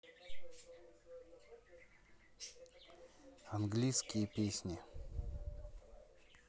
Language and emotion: Russian, neutral